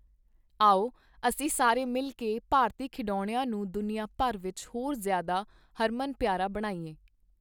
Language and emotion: Punjabi, neutral